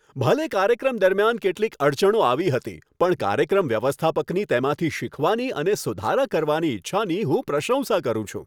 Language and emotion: Gujarati, happy